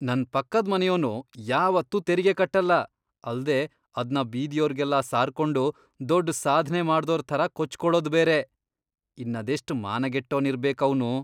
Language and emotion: Kannada, disgusted